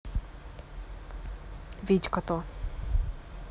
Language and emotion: Russian, neutral